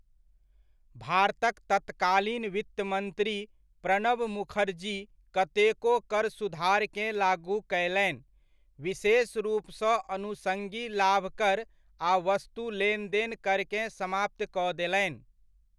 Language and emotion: Maithili, neutral